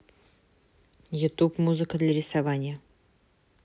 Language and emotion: Russian, neutral